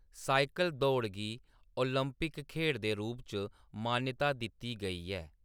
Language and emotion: Dogri, neutral